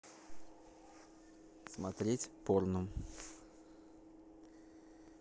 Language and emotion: Russian, neutral